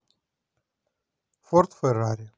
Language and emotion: Russian, neutral